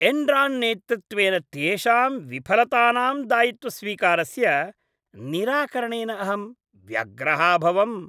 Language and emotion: Sanskrit, disgusted